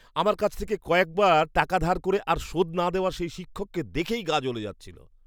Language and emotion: Bengali, disgusted